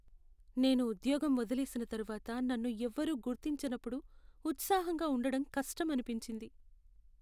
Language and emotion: Telugu, sad